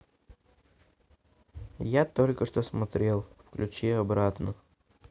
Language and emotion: Russian, neutral